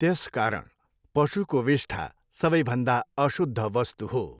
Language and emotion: Nepali, neutral